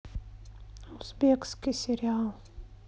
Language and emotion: Russian, neutral